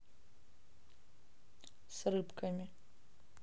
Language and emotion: Russian, neutral